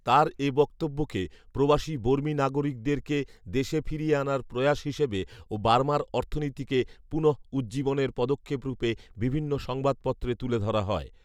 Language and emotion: Bengali, neutral